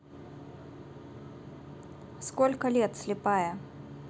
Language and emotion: Russian, neutral